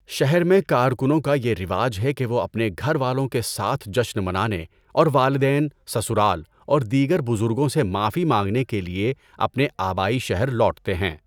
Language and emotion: Urdu, neutral